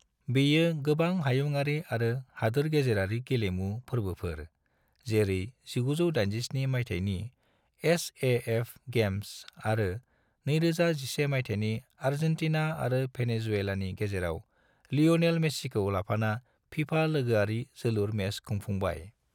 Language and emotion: Bodo, neutral